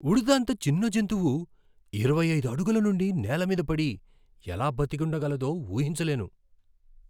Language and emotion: Telugu, surprised